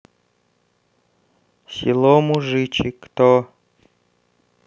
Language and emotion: Russian, neutral